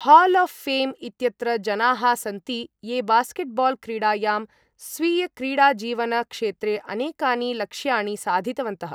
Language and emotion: Sanskrit, neutral